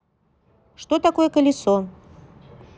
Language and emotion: Russian, neutral